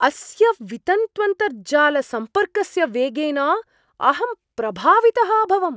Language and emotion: Sanskrit, surprised